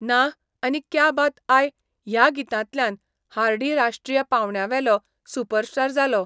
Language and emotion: Goan Konkani, neutral